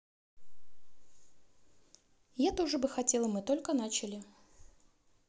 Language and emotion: Russian, neutral